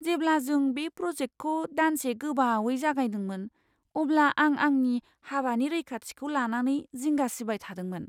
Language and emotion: Bodo, fearful